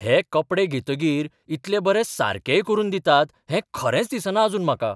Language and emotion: Goan Konkani, surprised